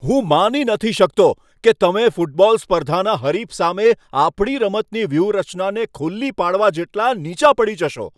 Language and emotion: Gujarati, angry